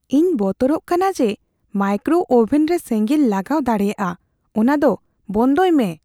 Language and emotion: Santali, fearful